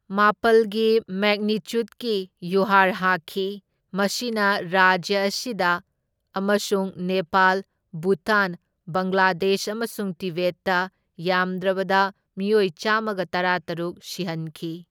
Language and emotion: Manipuri, neutral